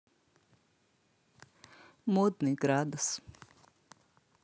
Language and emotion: Russian, neutral